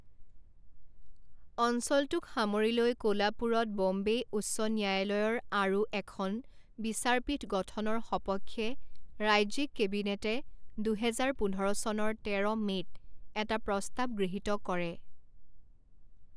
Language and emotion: Assamese, neutral